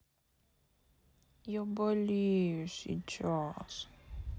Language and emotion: Russian, sad